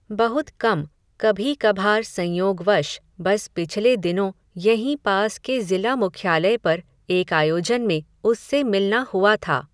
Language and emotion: Hindi, neutral